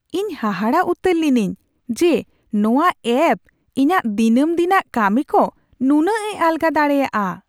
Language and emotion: Santali, surprised